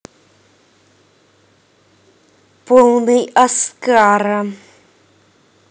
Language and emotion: Russian, angry